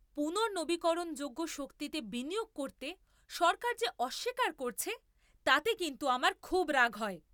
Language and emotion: Bengali, angry